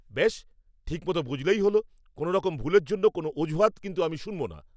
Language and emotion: Bengali, angry